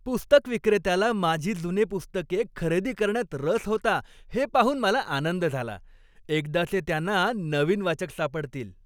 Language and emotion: Marathi, happy